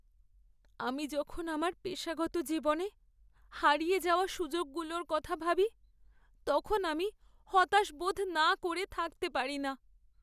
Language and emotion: Bengali, sad